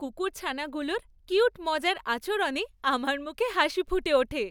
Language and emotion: Bengali, happy